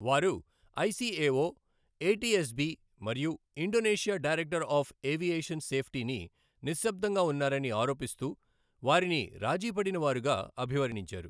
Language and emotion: Telugu, neutral